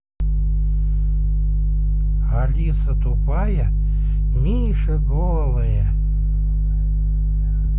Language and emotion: Russian, neutral